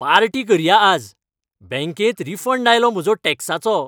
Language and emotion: Goan Konkani, happy